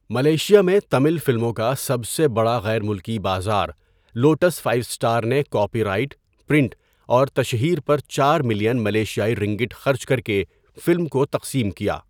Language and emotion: Urdu, neutral